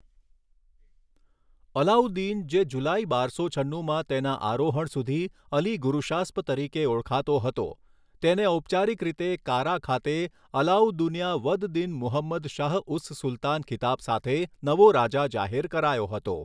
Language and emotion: Gujarati, neutral